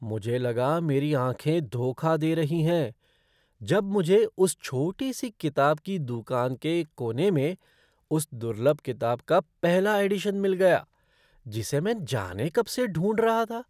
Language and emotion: Hindi, surprised